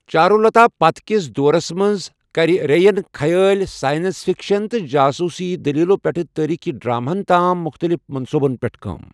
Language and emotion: Kashmiri, neutral